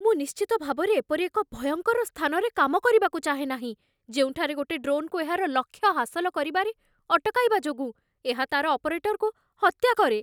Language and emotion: Odia, fearful